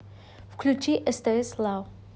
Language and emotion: Russian, neutral